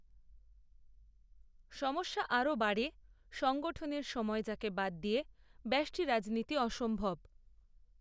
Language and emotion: Bengali, neutral